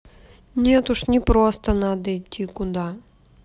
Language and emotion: Russian, sad